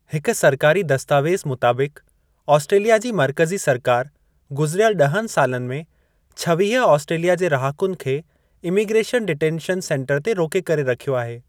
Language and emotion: Sindhi, neutral